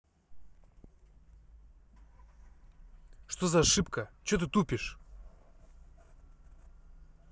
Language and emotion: Russian, angry